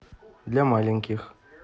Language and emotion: Russian, neutral